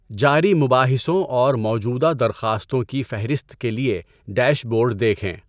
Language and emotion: Urdu, neutral